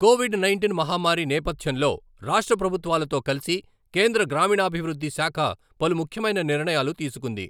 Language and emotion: Telugu, neutral